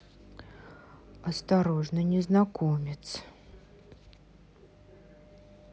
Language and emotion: Russian, neutral